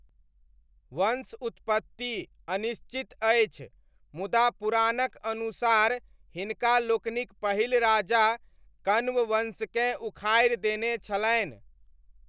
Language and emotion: Maithili, neutral